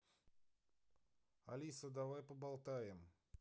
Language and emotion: Russian, neutral